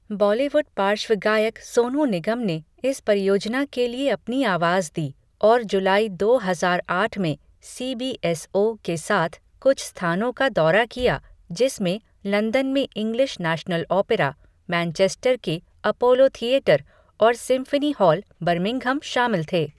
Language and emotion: Hindi, neutral